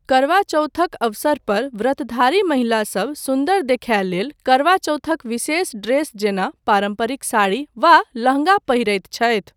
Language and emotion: Maithili, neutral